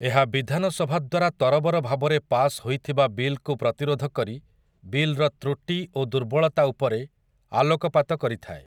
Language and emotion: Odia, neutral